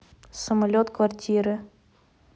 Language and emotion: Russian, neutral